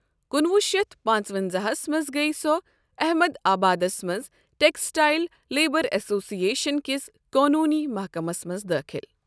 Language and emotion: Kashmiri, neutral